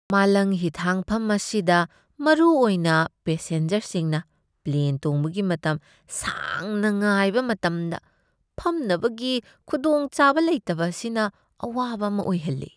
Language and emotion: Manipuri, disgusted